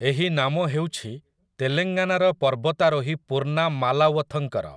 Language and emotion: Odia, neutral